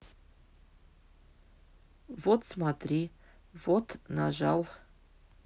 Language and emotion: Russian, neutral